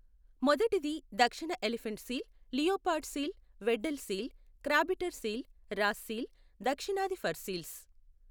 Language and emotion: Telugu, neutral